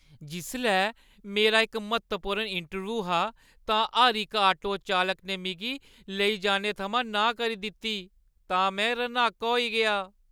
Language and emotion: Dogri, sad